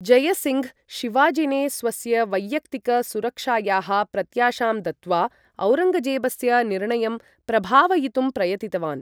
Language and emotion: Sanskrit, neutral